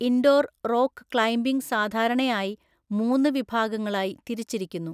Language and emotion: Malayalam, neutral